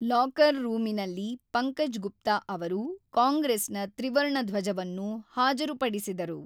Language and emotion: Kannada, neutral